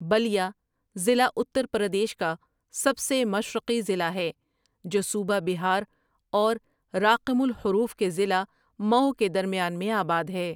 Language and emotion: Urdu, neutral